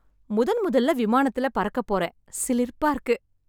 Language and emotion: Tamil, happy